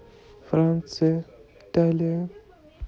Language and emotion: Russian, neutral